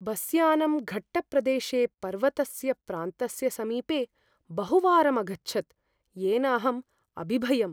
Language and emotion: Sanskrit, fearful